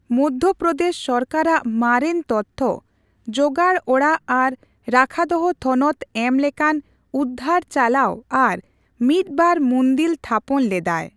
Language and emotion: Santali, neutral